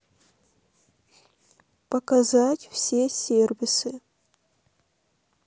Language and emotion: Russian, neutral